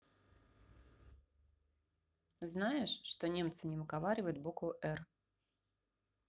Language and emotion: Russian, neutral